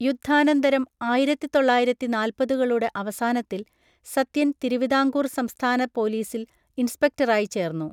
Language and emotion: Malayalam, neutral